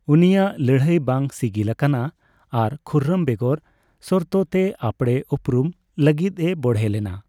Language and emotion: Santali, neutral